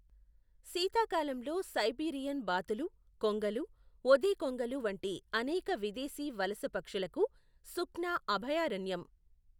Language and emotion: Telugu, neutral